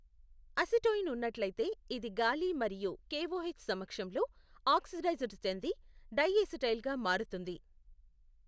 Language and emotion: Telugu, neutral